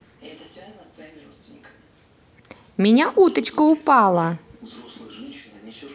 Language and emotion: Russian, positive